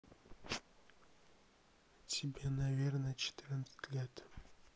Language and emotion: Russian, sad